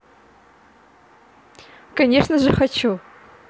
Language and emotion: Russian, positive